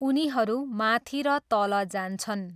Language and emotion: Nepali, neutral